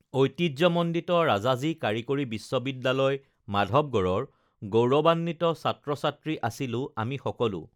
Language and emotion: Assamese, neutral